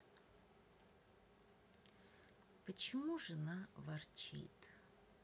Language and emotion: Russian, sad